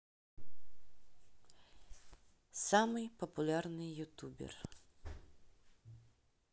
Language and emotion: Russian, neutral